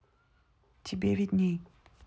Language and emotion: Russian, neutral